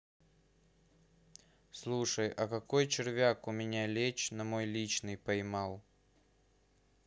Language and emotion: Russian, neutral